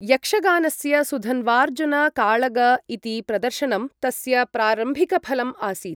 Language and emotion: Sanskrit, neutral